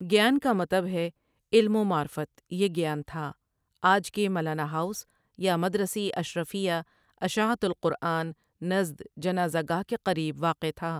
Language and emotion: Urdu, neutral